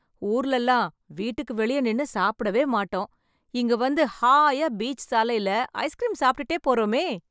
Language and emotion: Tamil, happy